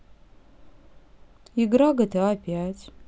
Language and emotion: Russian, neutral